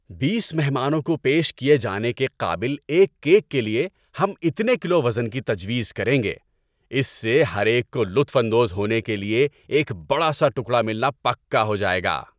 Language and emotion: Urdu, happy